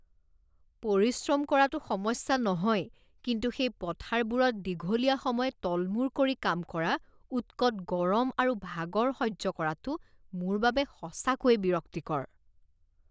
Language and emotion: Assamese, disgusted